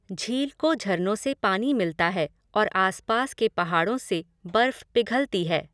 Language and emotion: Hindi, neutral